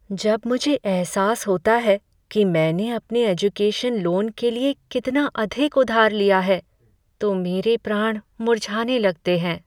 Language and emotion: Hindi, sad